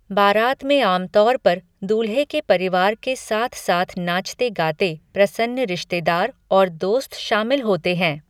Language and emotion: Hindi, neutral